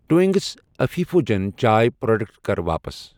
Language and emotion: Kashmiri, neutral